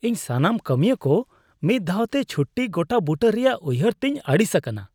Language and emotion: Santali, disgusted